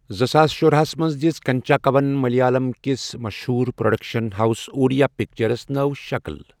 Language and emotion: Kashmiri, neutral